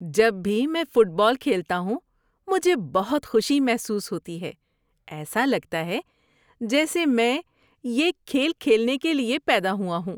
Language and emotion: Urdu, happy